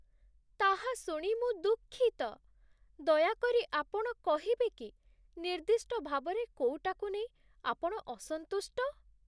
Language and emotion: Odia, sad